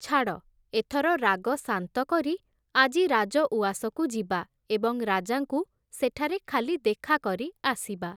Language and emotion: Odia, neutral